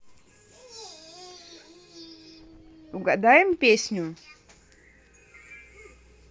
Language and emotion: Russian, positive